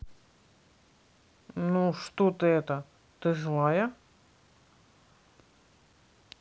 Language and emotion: Russian, neutral